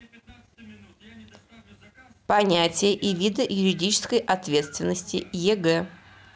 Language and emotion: Russian, neutral